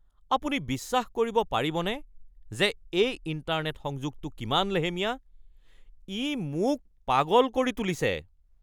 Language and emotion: Assamese, angry